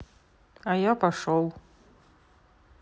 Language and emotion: Russian, neutral